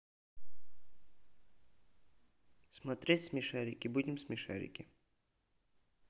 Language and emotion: Russian, neutral